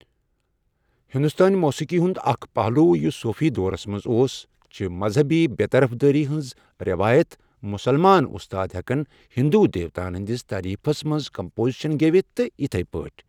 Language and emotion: Kashmiri, neutral